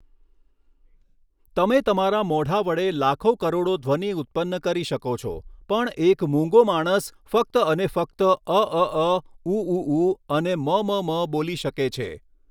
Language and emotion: Gujarati, neutral